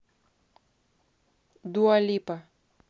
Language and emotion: Russian, neutral